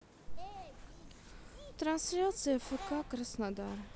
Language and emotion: Russian, sad